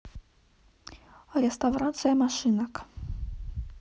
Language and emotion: Russian, neutral